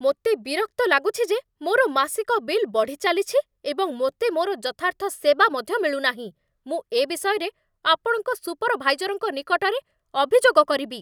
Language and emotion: Odia, angry